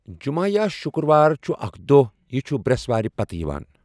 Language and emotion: Kashmiri, neutral